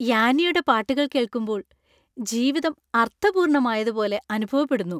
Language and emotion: Malayalam, happy